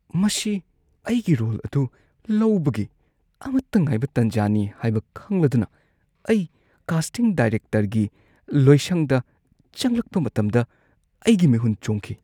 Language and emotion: Manipuri, fearful